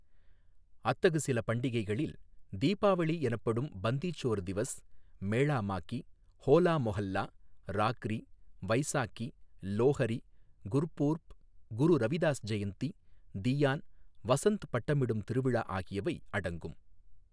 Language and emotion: Tamil, neutral